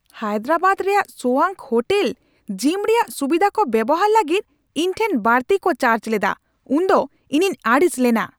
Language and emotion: Santali, angry